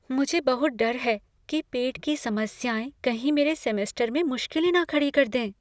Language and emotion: Hindi, fearful